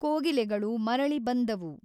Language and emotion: Kannada, neutral